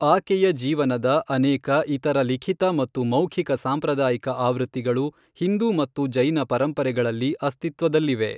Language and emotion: Kannada, neutral